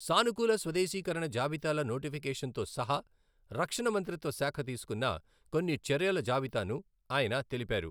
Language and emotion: Telugu, neutral